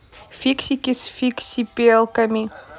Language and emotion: Russian, neutral